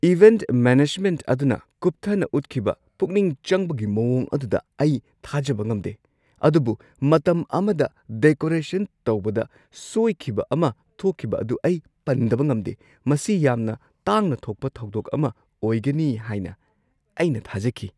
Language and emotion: Manipuri, surprised